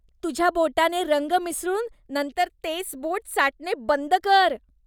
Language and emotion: Marathi, disgusted